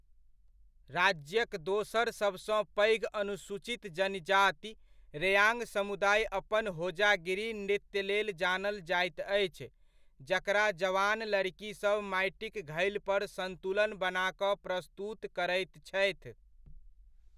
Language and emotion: Maithili, neutral